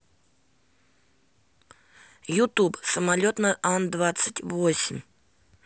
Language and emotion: Russian, neutral